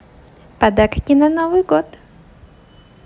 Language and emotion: Russian, positive